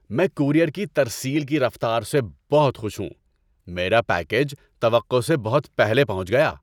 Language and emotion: Urdu, happy